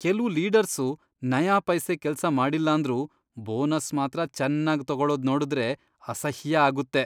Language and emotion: Kannada, disgusted